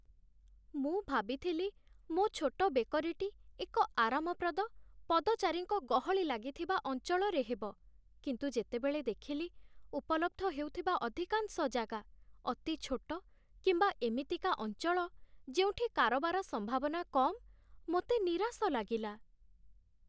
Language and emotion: Odia, sad